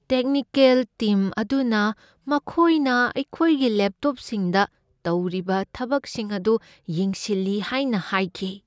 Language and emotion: Manipuri, fearful